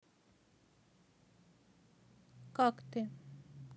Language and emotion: Russian, sad